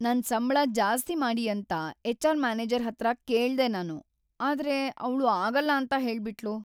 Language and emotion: Kannada, sad